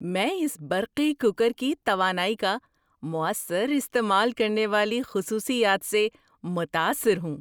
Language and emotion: Urdu, surprised